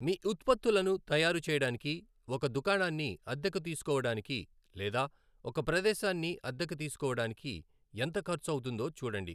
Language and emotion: Telugu, neutral